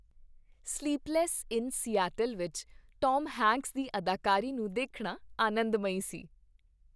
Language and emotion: Punjabi, happy